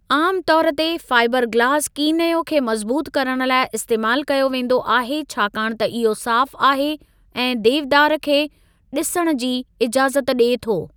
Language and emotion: Sindhi, neutral